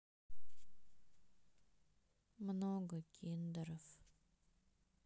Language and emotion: Russian, sad